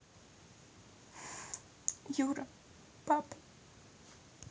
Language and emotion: Russian, sad